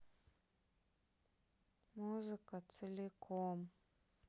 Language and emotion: Russian, sad